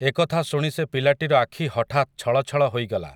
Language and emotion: Odia, neutral